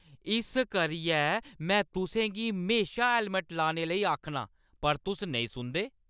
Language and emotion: Dogri, angry